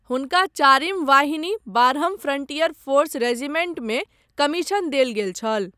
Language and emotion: Maithili, neutral